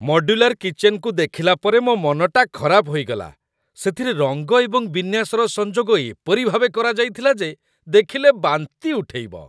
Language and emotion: Odia, disgusted